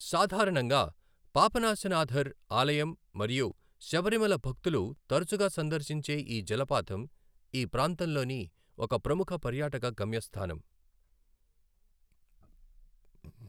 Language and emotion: Telugu, neutral